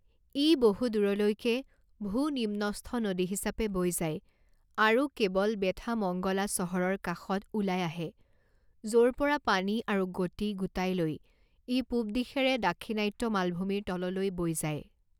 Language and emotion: Assamese, neutral